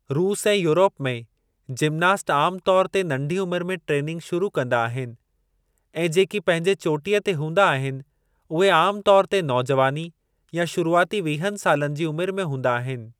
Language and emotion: Sindhi, neutral